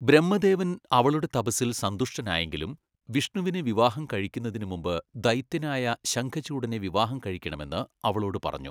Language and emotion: Malayalam, neutral